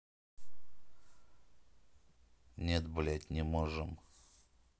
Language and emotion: Russian, neutral